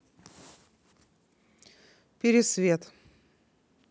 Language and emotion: Russian, neutral